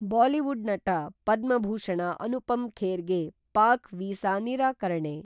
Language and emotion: Kannada, neutral